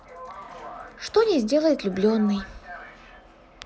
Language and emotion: Russian, neutral